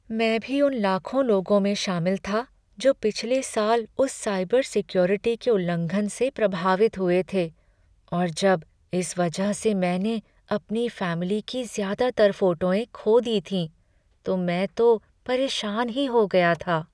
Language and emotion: Hindi, sad